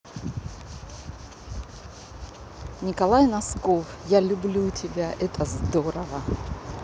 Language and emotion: Russian, positive